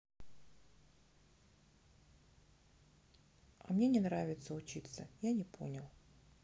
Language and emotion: Russian, neutral